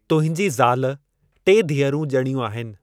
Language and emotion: Sindhi, neutral